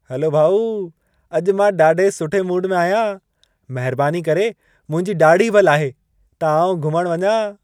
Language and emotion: Sindhi, happy